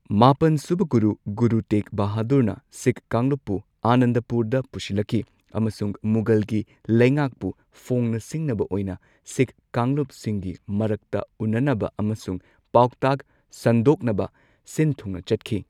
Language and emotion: Manipuri, neutral